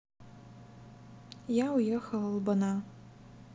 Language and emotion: Russian, sad